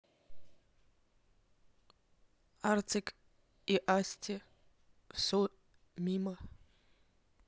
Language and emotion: Russian, neutral